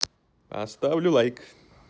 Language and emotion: Russian, positive